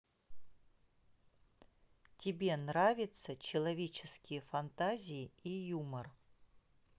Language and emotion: Russian, neutral